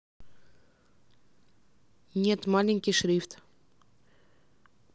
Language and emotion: Russian, neutral